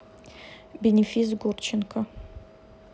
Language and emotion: Russian, neutral